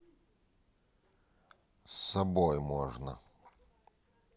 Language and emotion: Russian, neutral